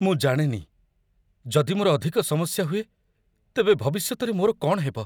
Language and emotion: Odia, fearful